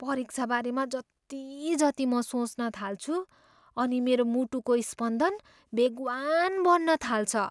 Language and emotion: Nepali, fearful